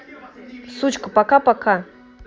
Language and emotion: Russian, angry